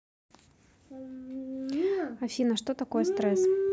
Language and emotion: Russian, neutral